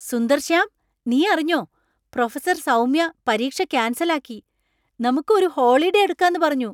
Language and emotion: Malayalam, surprised